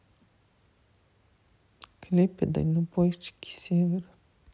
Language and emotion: Russian, sad